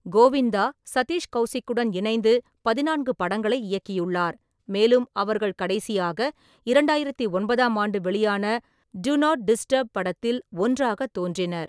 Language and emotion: Tamil, neutral